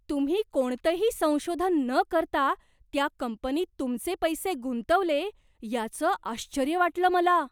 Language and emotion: Marathi, surprised